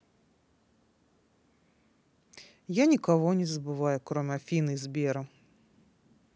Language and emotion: Russian, sad